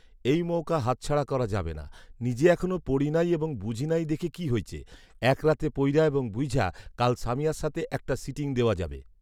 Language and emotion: Bengali, neutral